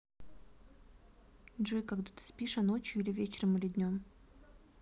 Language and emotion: Russian, neutral